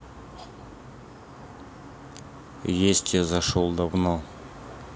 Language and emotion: Russian, neutral